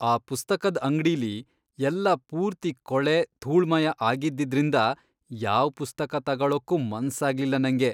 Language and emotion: Kannada, disgusted